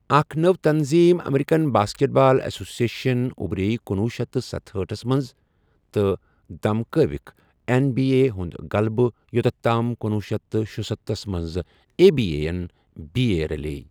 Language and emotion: Kashmiri, neutral